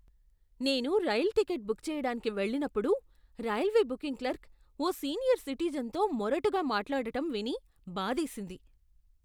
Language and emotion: Telugu, disgusted